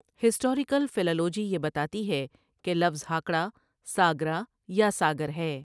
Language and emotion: Urdu, neutral